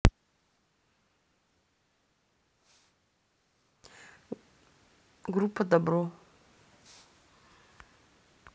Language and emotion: Russian, neutral